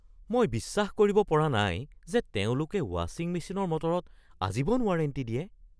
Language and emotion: Assamese, surprised